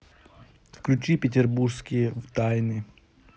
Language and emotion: Russian, neutral